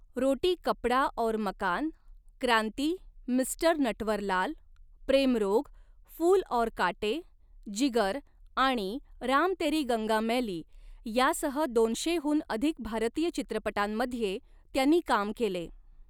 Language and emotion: Marathi, neutral